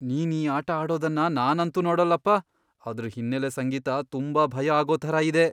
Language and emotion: Kannada, fearful